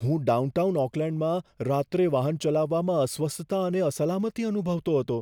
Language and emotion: Gujarati, fearful